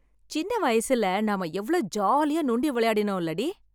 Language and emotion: Tamil, happy